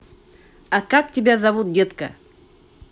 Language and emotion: Russian, positive